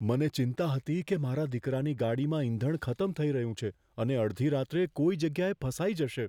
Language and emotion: Gujarati, fearful